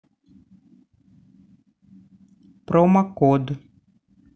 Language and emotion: Russian, neutral